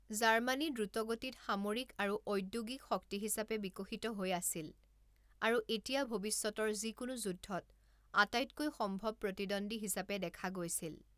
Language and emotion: Assamese, neutral